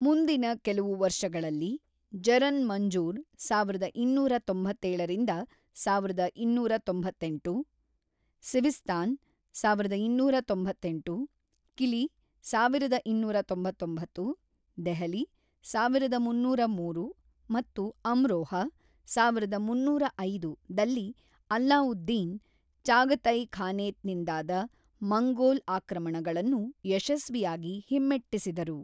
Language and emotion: Kannada, neutral